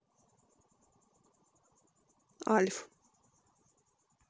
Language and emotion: Russian, neutral